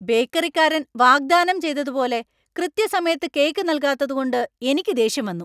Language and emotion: Malayalam, angry